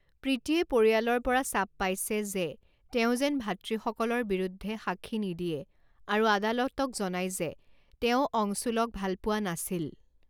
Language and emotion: Assamese, neutral